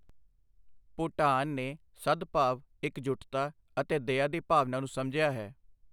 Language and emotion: Punjabi, neutral